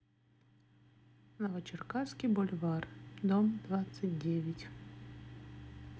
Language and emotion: Russian, neutral